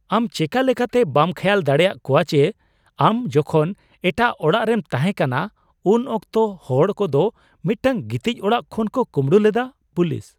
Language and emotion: Santali, surprised